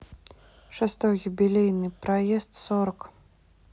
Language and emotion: Russian, neutral